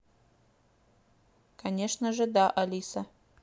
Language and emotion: Russian, neutral